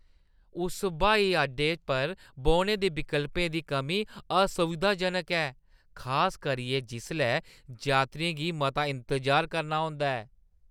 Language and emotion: Dogri, disgusted